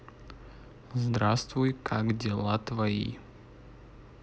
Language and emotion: Russian, neutral